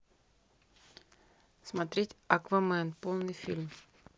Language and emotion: Russian, neutral